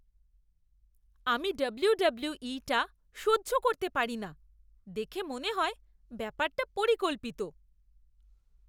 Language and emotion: Bengali, disgusted